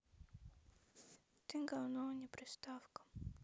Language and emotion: Russian, sad